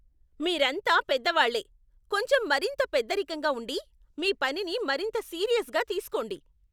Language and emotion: Telugu, angry